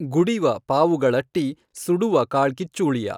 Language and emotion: Kannada, neutral